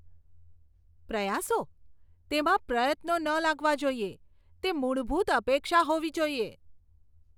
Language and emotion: Gujarati, disgusted